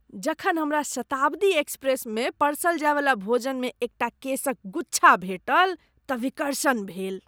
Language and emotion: Maithili, disgusted